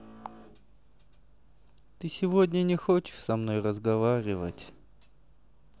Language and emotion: Russian, sad